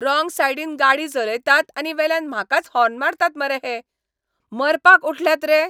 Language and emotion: Goan Konkani, angry